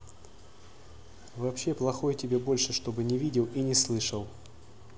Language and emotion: Russian, neutral